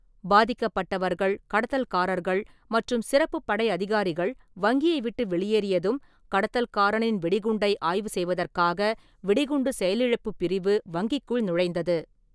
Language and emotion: Tamil, neutral